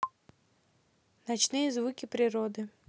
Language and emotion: Russian, neutral